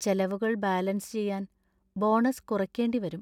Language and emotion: Malayalam, sad